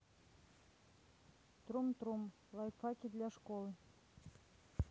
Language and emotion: Russian, neutral